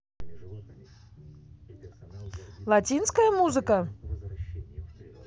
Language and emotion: Russian, positive